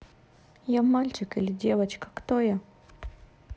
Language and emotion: Russian, neutral